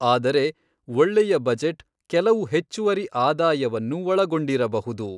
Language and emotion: Kannada, neutral